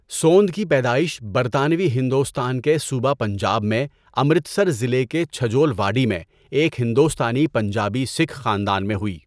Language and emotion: Urdu, neutral